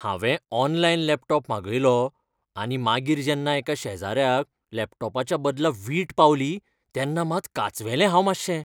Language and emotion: Goan Konkani, fearful